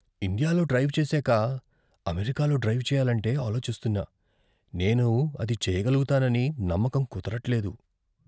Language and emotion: Telugu, fearful